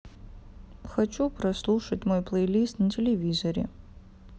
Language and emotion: Russian, sad